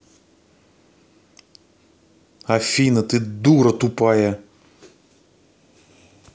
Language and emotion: Russian, angry